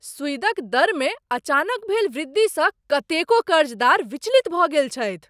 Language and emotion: Maithili, surprised